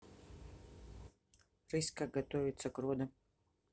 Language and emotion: Russian, neutral